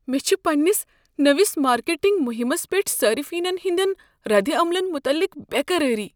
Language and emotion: Kashmiri, fearful